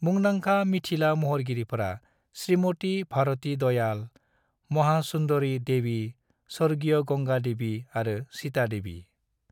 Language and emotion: Bodo, neutral